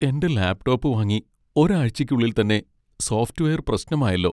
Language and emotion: Malayalam, sad